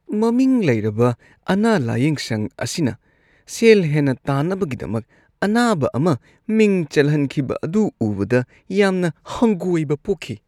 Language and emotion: Manipuri, disgusted